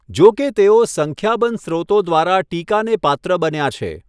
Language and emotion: Gujarati, neutral